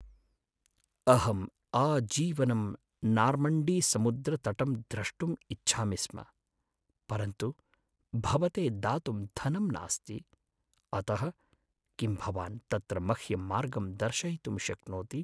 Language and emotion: Sanskrit, sad